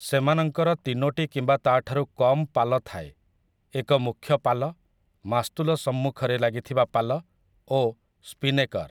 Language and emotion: Odia, neutral